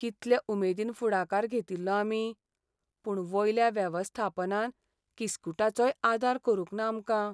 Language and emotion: Goan Konkani, sad